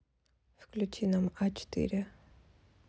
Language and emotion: Russian, neutral